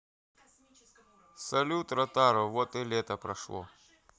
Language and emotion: Russian, neutral